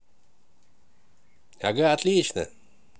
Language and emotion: Russian, positive